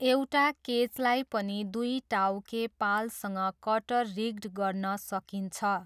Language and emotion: Nepali, neutral